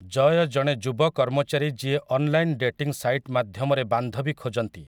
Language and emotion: Odia, neutral